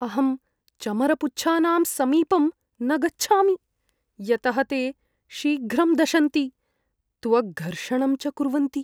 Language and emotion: Sanskrit, fearful